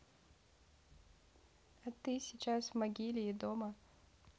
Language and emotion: Russian, neutral